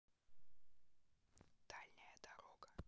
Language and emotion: Russian, neutral